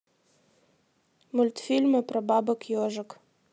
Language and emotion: Russian, neutral